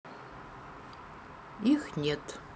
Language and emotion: Russian, neutral